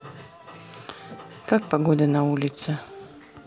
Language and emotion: Russian, neutral